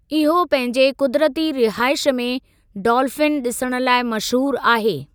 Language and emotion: Sindhi, neutral